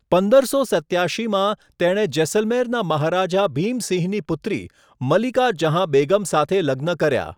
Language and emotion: Gujarati, neutral